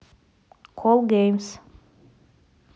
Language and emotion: Russian, neutral